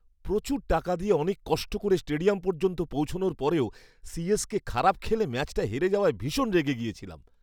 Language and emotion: Bengali, angry